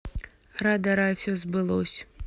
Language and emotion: Russian, neutral